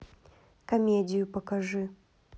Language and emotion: Russian, neutral